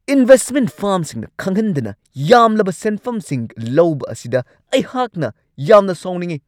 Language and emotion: Manipuri, angry